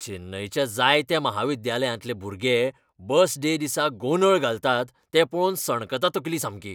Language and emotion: Goan Konkani, angry